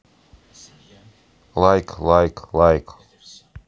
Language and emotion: Russian, neutral